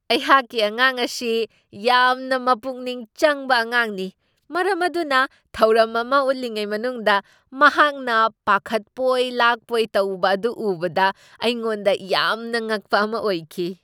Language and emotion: Manipuri, surprised